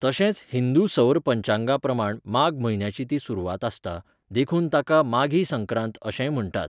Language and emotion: Goan Konkani, neutral